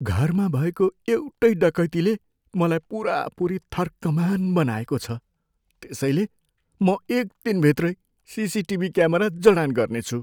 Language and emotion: Nepali, fearful